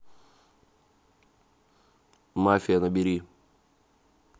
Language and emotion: Russian, neutral